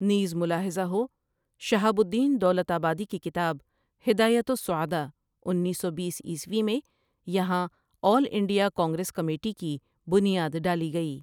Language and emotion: Urdu, neutral